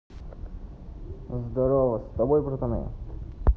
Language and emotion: Russian, neutral